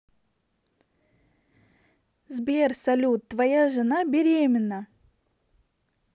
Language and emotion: Russian, positive